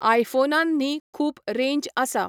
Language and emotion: Goan Konkani, neutral